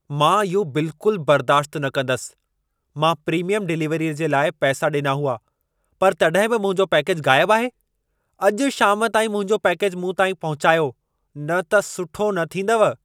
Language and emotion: Sindhi, angry